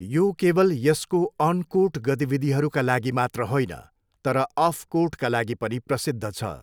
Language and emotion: Nepali, neutral